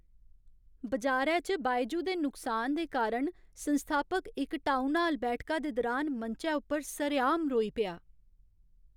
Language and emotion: Dogri, sad